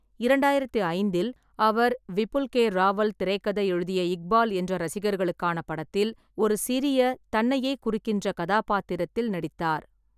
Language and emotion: Tamil, neutral